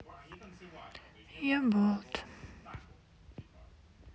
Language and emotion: Russian, sad